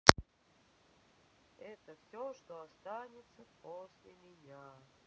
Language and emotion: Russian, neutral